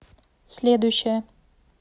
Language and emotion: Russian, neutral